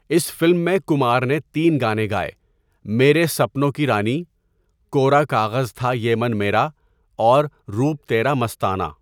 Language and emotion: Urdu, neutral